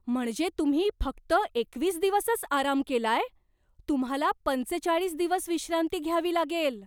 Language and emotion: Marathi, surprised